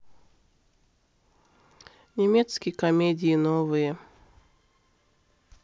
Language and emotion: Russian, neutral